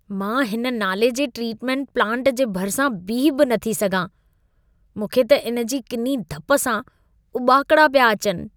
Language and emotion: Sindhi, disgusted